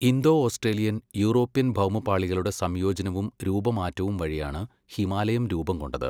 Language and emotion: Malayalam, neutral